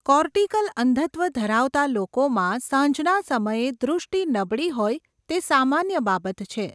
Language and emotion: Gujarati, neutral